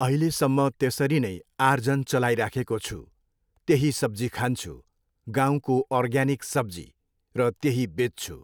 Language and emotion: Nepali, neutral